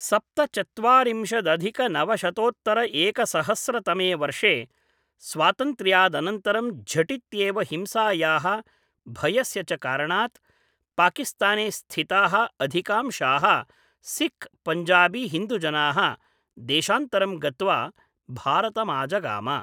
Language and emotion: Sanskrit, neutral